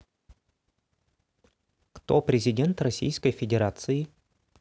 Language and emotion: Russian, neutral